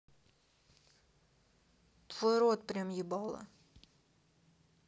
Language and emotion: Russian, neutral